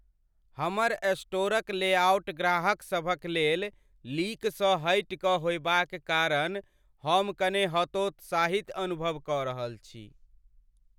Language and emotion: Maithili, sad